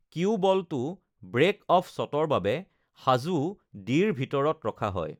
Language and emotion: Assamese, neutral